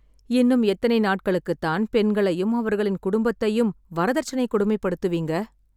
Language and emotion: Tamil, sad